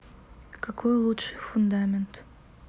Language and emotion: Russian, neutral